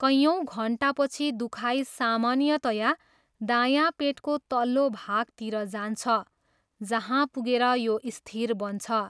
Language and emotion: Nepali, neutral